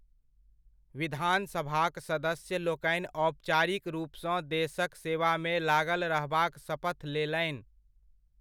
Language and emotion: Maithili, neutral